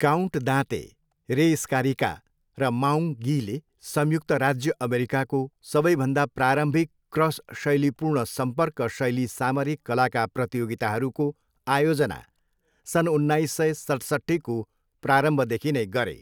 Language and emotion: Nepali, neutral